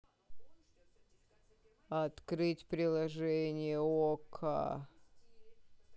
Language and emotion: Russian, neutral